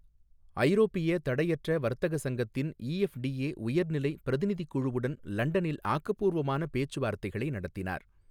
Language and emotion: Tamil, neutral